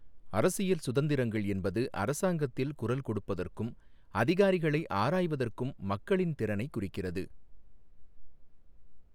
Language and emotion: Tamil, neutral